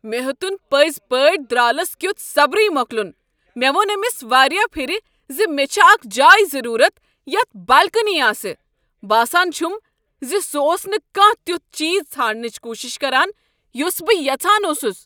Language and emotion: Kashmiri, angry